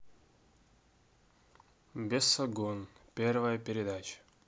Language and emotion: Russian, neutral